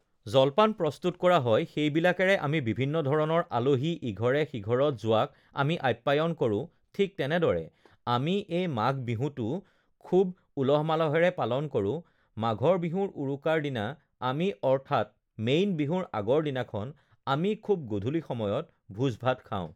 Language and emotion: Assamese, neutral